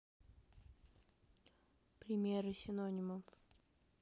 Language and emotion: Russian, neutral